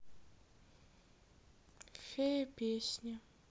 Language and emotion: Russian, sad